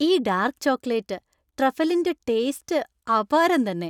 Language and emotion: Malayalam, happy